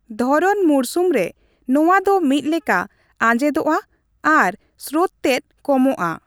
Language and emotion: Santali, neutral